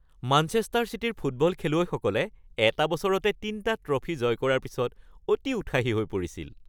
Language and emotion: Assamese, happy